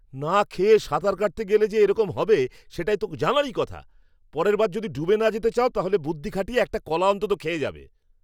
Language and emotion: Bengali, angry